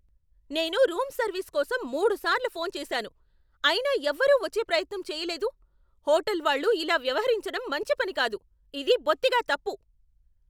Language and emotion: Telugu, angry